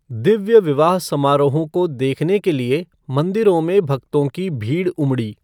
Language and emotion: Hindi, neutral